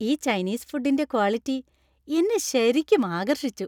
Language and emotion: Malayalam, happy